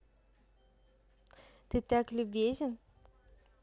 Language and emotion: Russian, positive